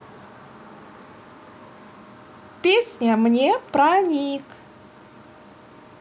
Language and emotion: Russian, positive